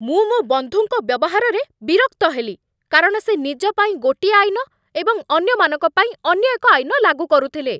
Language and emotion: Odia, angry